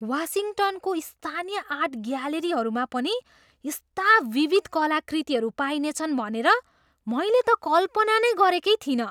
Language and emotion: Nepali, surprised